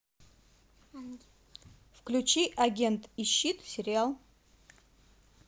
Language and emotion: Russian, neutral